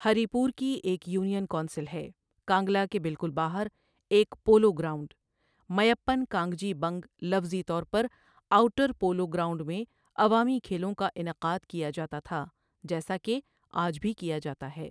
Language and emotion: Urdu, neutral